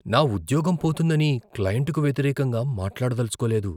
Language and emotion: Telugu, fearful